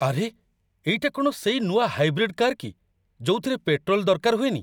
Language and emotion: Odia, surprised